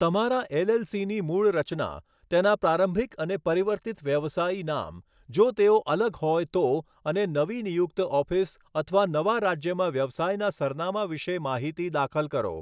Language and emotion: Gujarati, neutral